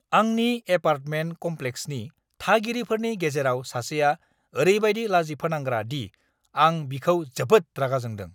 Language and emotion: Bodo, angry